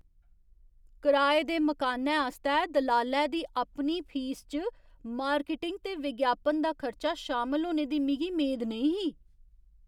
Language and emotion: Dogri, surprised